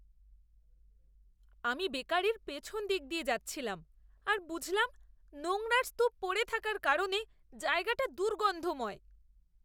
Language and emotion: Bengali, disgusted